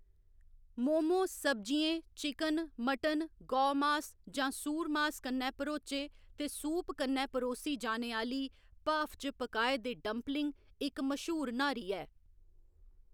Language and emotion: Dogri, neutral